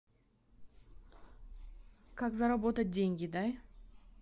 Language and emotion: Russian, neutral